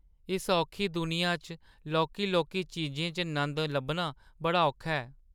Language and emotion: Dogri, sad